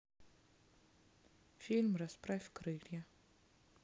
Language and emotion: Russian, neutral